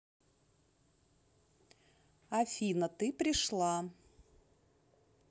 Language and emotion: Russian, neutral